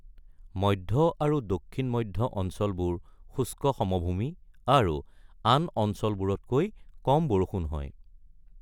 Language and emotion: Assamese, neutral